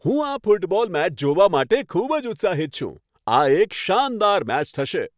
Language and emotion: Gujarati, happy